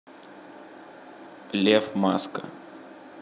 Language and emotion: Russian, neutral